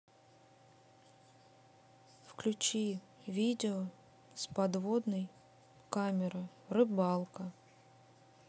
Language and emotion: Russian, neutral